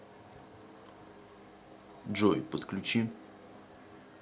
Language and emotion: Russian, neutral